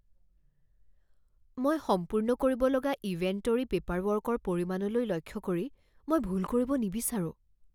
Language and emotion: Assamese, fearful